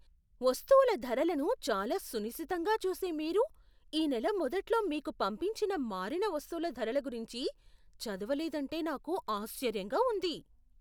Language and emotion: Telugu, surprised